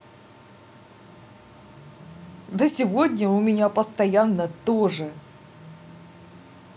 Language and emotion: Russian, positive